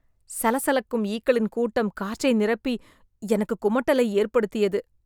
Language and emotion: Tamil, disgusted